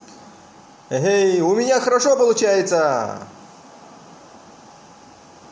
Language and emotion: Russian, positive